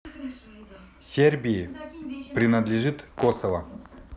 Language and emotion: Russian, neutral